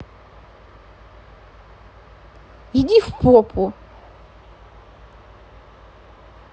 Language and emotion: Russian, angry